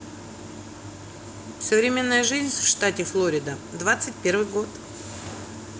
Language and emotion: Russian, neutral